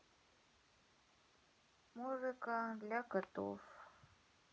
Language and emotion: Russian, sad